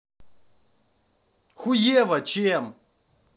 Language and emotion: Russian, angry